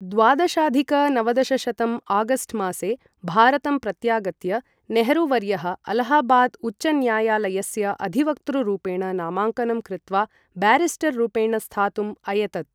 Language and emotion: Sanskrit, neutral